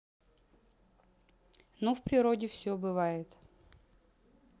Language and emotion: Russian, neutral